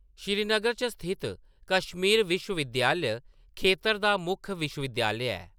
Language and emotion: Dogri, neutral